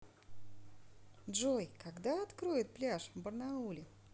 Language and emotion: Russian, positive